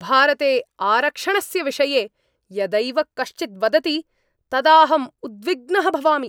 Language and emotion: Sanskrit, angry